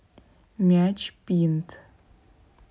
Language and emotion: Russian, neutral